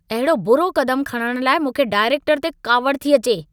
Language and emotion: Sindhi, angry